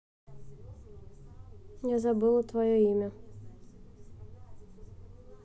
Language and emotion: Russian, neutral